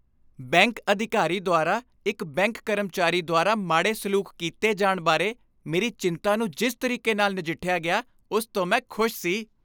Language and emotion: Punjabi, happy